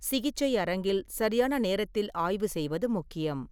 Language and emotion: Tamil, neutral